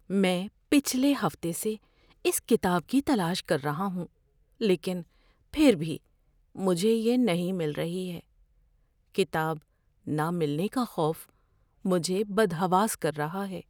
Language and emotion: Urdu, fearful